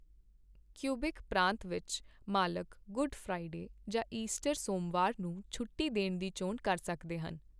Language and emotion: Punjabi, neutral